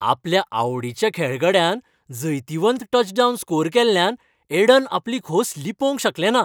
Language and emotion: Goan Konkani, happy